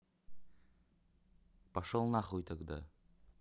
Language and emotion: Russian, angry